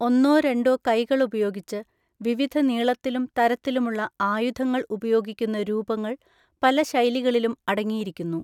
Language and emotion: Malayalam, neutral